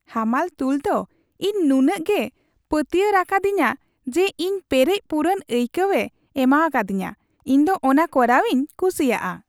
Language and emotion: Santali, happy